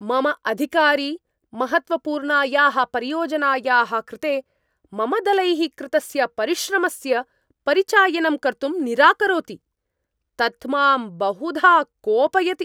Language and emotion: Sanskrit, angry